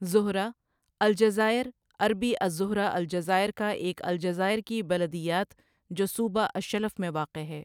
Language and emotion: Urdu, neutral